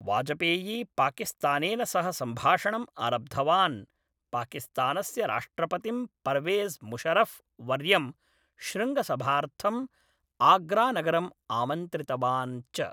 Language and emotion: Sanskrit, neutral